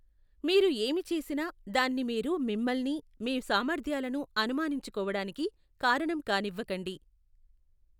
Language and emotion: Telugu, neutral